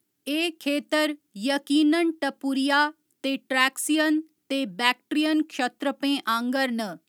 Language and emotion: Dogri, neutral